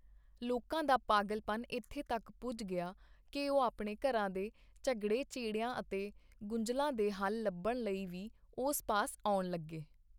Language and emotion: Punjabi, neutral